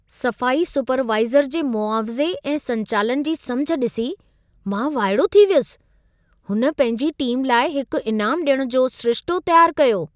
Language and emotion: Sindhi, surprised